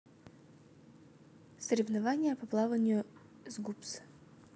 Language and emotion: Russian, neutral